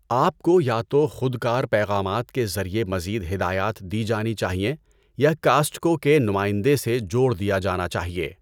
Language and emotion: Urdu, neutral